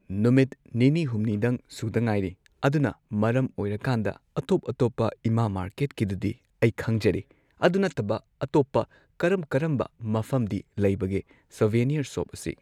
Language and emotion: Manipuri, neutral